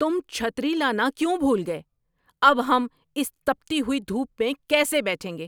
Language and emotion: Urdu, angry